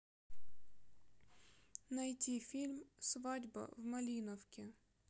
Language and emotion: Russian, sad